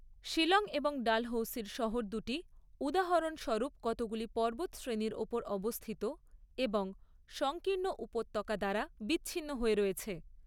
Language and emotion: Bengali, neutral